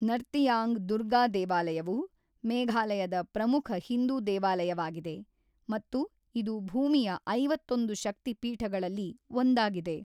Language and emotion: Kannada, neutral